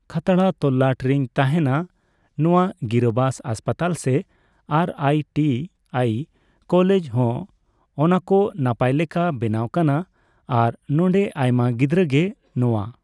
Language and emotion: Santali, neutral